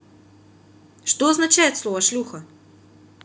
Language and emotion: Russian, neutral